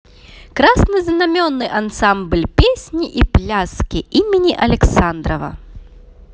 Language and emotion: Russian, positive